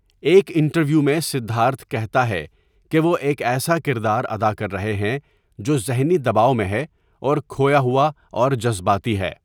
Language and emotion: Urdu, neutral